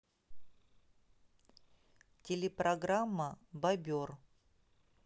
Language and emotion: Russian, neutral